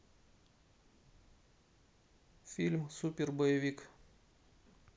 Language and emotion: Russian, neutral